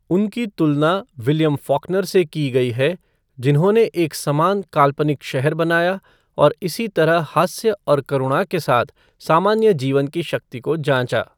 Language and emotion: Hindi, neutral